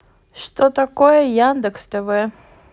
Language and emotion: Russian, neutral